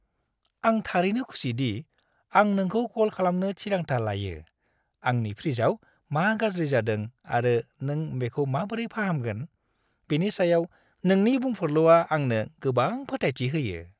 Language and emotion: Bodo, happy